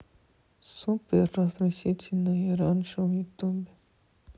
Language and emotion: Russian, sad